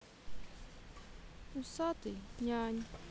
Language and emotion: Russian, sad